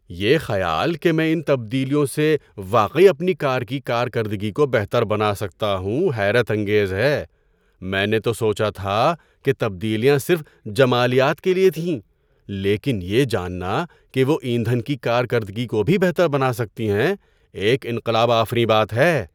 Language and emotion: Urdu, surprised